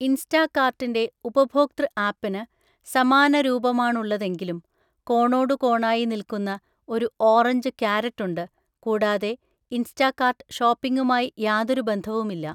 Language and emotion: Malayalam, neutral